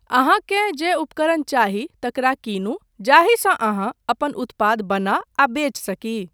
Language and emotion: Maithili, neutral